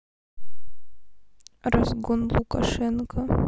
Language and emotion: Russian, neutral